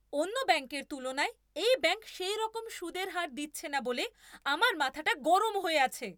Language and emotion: Bengali, angry